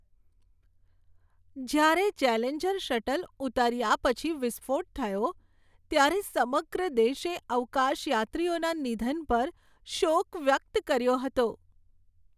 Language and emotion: Gujarati, sad